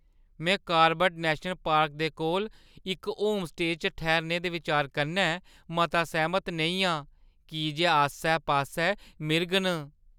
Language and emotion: Dogri, fearful